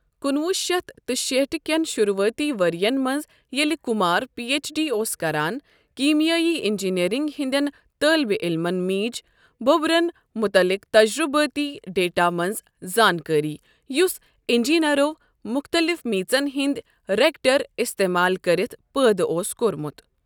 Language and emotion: Kashmiri, neutral